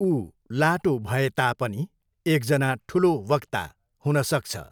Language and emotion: Nepali, neutral